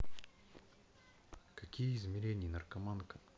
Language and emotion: Russian, neutral